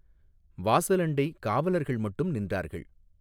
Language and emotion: Tamil, neutral